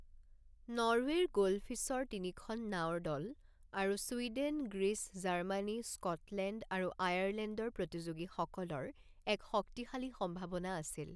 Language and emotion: Assamese, neutral